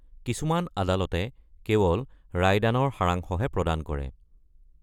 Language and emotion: Assamese, neutral